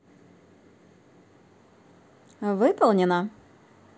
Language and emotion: Russian, positive